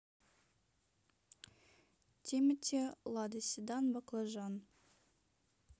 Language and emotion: Russian, neutral